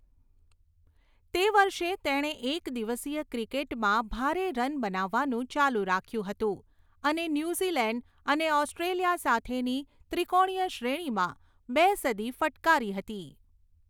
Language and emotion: Gujarati, neutral